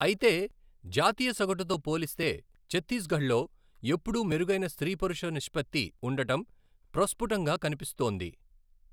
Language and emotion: Telugu, neutral